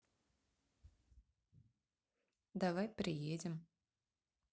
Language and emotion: Russian, neutral